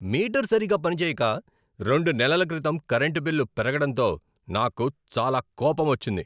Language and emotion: Telugu, angry